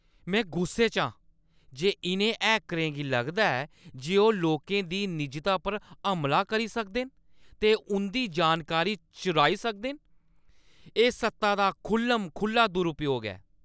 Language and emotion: Dogri, angry